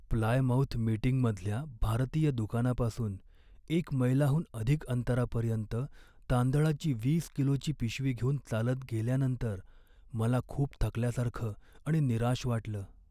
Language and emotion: Marathi, sad